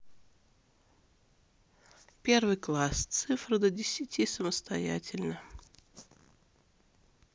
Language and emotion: Russian, neutral